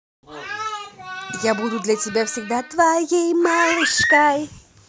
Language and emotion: Russian, positive